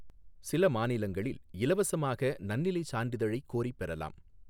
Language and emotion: Tamil, neutral